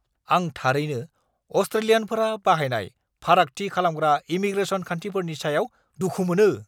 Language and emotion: Bodo, angry